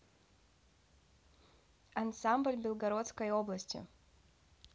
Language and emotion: Russian, neutral